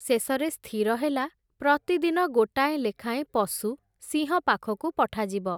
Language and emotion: Odia, neutral